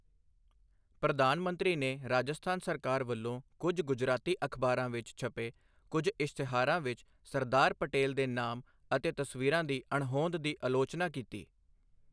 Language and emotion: Punjabi, neutral